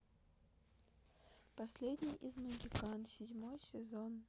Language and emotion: Russian, neutral